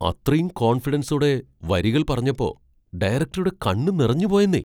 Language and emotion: Malayalam, surprised